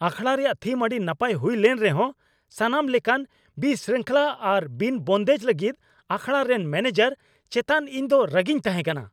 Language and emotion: Santali, angry